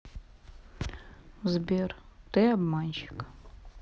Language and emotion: Russian, sad